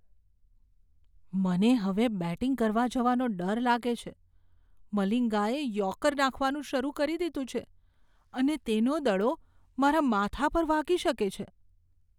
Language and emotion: Gujarati, fearful